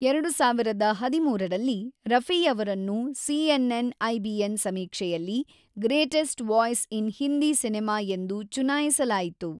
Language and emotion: Kannada, neutral